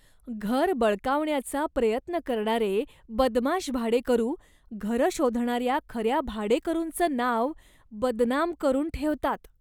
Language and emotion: Marathi, disgusted